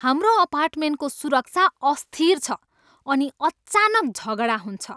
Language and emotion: Nepali, angry